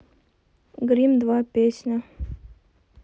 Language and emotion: Russian, neutral